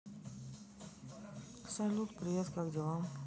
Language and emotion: Russian, neutral